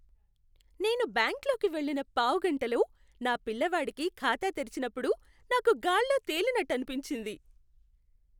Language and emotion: Telugu, happy